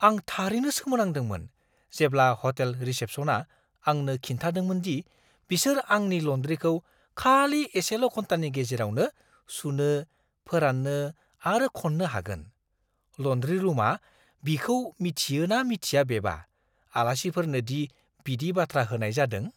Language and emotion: Bodo, surprised